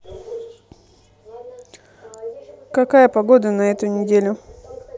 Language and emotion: Russian, neutral